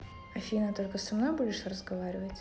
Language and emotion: Russian, neutral